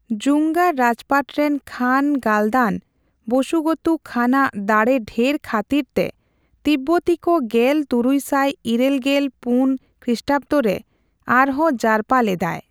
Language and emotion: Santali, neutral